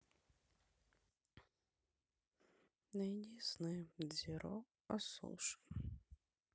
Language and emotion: Russian, sad